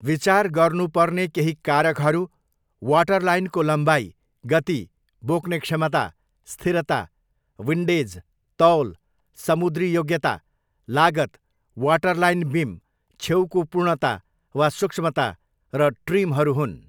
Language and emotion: Nepali, neutral